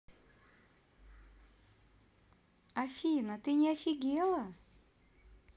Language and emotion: Russian, neutral